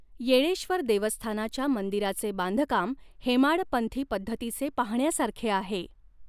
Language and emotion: Marathi, neutral